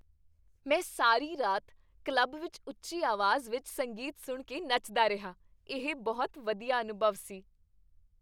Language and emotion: Punjabi, happy